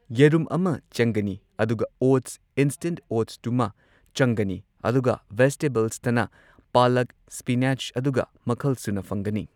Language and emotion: Manipuri, neutral